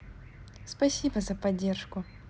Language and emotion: Russian, positive